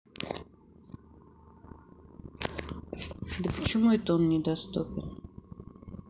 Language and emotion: Russian, sad